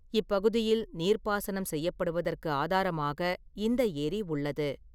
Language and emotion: Tamil, neutral